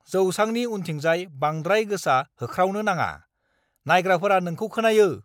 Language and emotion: Bodo, angry